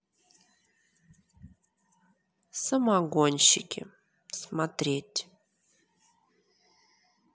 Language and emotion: Russian, neutral